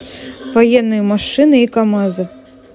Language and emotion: Russian, neutral